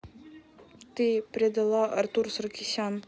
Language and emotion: Russian, neutral